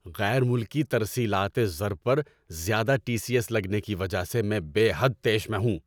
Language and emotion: Urdu, angry